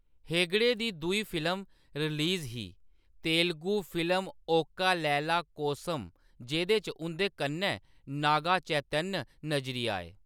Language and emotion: Dogri, neutral